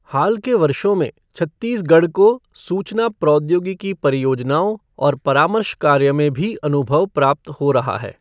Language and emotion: Hindi, neutral